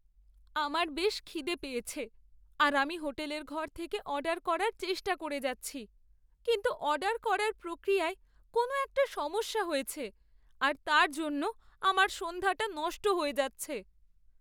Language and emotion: Bengali, sad